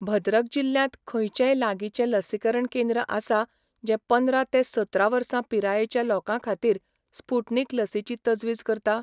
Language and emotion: Goan Konkani, neutral